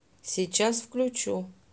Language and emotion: Russian, neutral